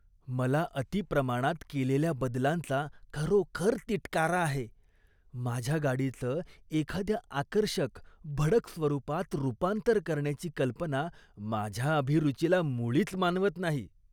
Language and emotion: Marathi, disgusted